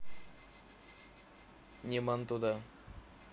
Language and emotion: Russian, neutral